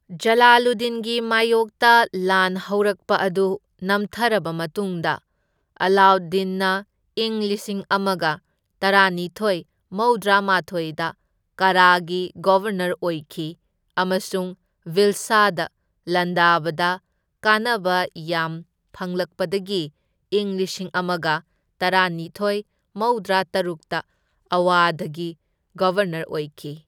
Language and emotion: Manipuri, neutral